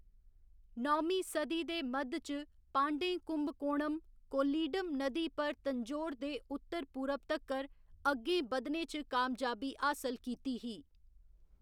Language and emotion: Dogri, neutral